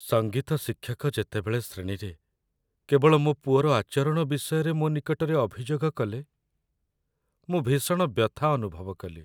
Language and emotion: Odia, sad